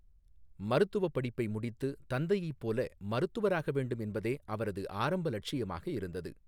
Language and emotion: Tamil, neutral